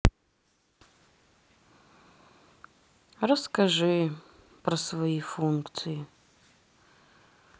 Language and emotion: Russian, sad